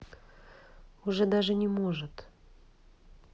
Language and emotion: Russian, neutral